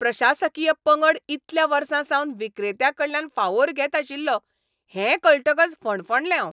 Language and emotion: Goan Konkani, angry